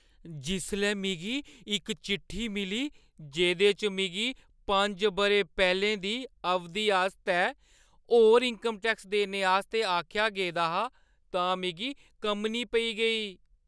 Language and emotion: Dogri, fearful